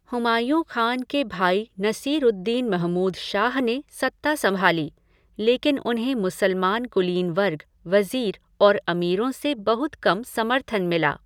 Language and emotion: Hindi, neutral